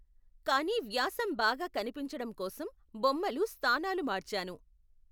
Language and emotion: Telugu, neutral